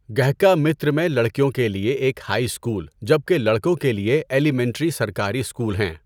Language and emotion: Urdu, neutral